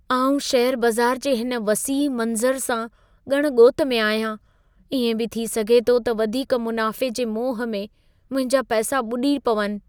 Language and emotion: Sindhi, fearful